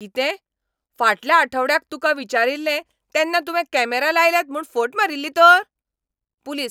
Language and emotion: Goan Konkani, angry